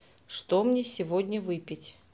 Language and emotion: Russian, neutral